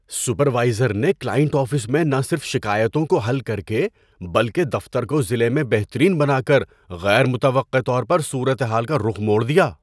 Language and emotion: Urdu, surprised